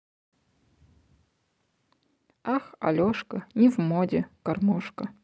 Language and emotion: Russian, neutral